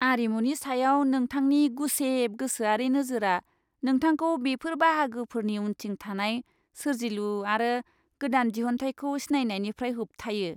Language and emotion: Bodo, disgusted